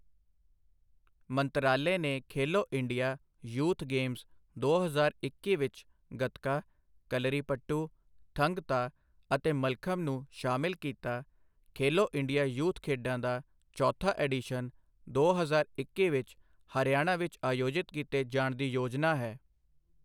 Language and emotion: Punjabi, neutral